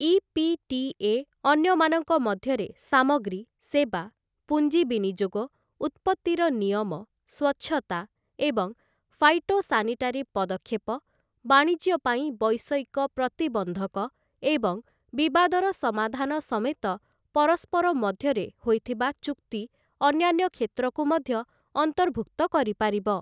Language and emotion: Odia, neutral